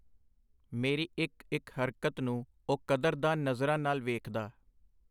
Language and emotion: Punjabi, neutral